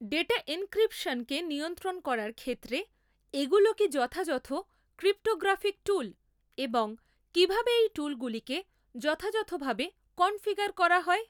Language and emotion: Bengali, neutral